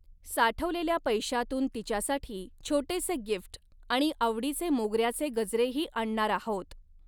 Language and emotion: Marathi, neutral